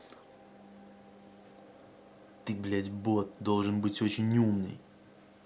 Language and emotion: Russian, angry